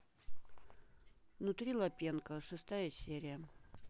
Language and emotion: Russian, neutral